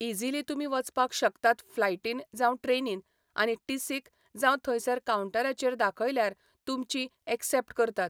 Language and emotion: Goan Konkani, neutral